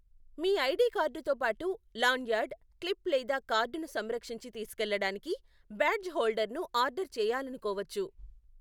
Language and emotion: Telugu, neutral